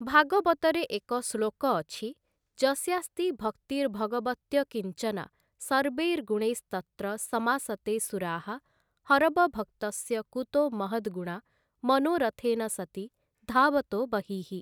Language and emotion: Odia, neutral